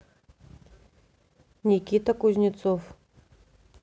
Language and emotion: Russian, neutral